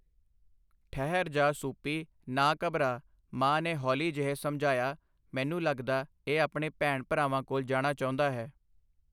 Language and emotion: Punjabi, neutral